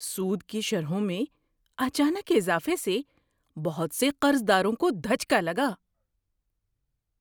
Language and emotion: Urdu, surprised